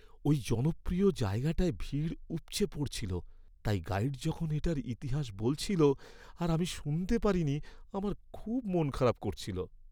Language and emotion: Bengali, sad